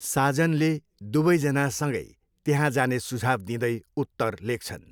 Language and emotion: Nepali, neutral